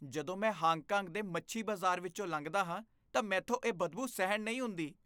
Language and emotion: Punjabi, disgusted